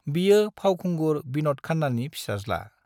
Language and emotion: Bodo, neutral